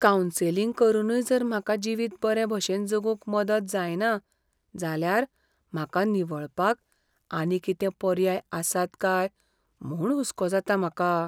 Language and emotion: Goan Konkani, fearful